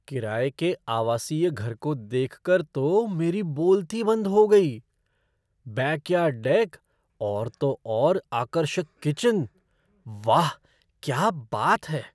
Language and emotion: Hindi, surprised